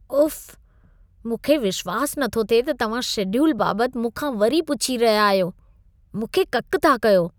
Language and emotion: Sindhi, disgusted